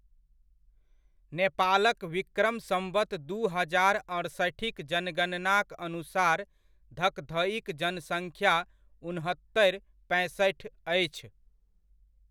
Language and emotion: Maithili, neutral